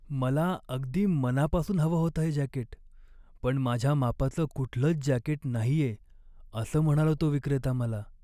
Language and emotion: Marathi, sad